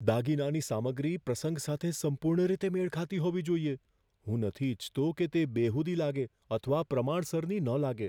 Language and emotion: Gujarati, fearful